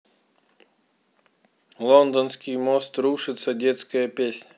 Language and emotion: Russian, neutral